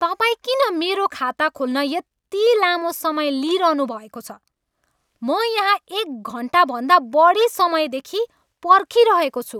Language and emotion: Nepali, angry